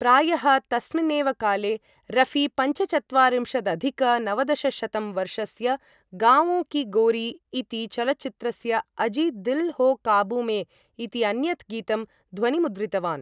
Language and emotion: Sanskrit, neutral